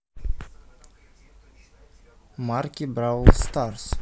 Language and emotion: Russian, neutral